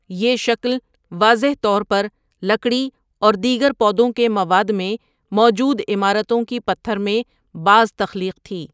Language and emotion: Urdu, neutral